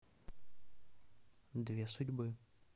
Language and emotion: Russian, neutral